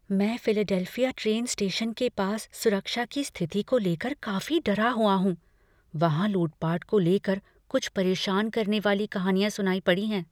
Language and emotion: Hindi, fearful